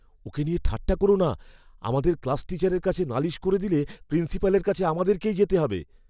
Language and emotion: Bengali, fearful